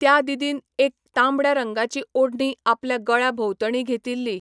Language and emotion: Goan Konkani, neutral